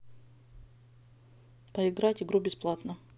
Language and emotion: Russian, neutral